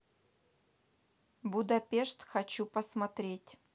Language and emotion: Russian, neutral